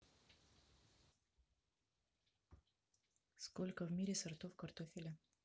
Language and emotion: Russian, neutral